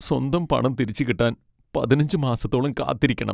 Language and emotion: Malayalam, sad